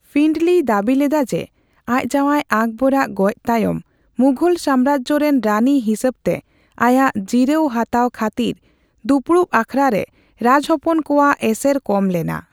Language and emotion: Santali, neutral